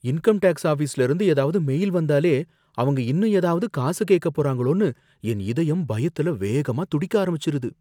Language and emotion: Tamil, fearful